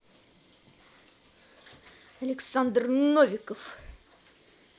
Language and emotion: Russian, angry